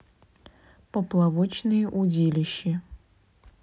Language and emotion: Russian, neutral